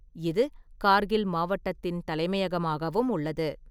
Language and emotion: Tamil, neutral